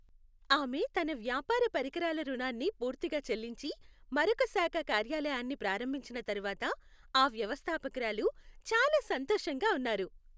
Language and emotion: Telugu, happy